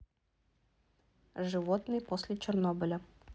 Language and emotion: Russian, neutral